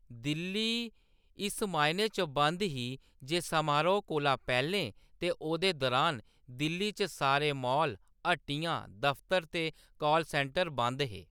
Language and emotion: Dogri, neutral